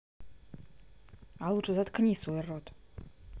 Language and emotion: Russian, angry